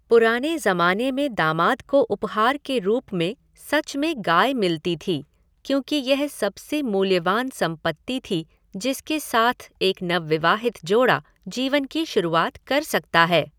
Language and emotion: Hindi, neutral